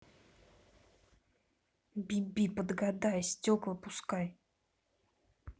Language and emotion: Russian, angry